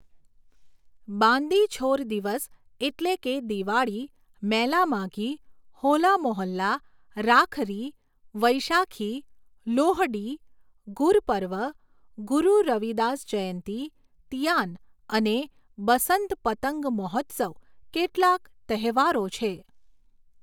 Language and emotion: Gujarati, neutral